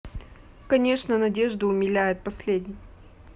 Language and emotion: Russian, neutral